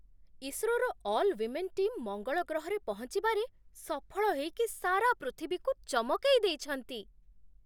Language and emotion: Odia, surprised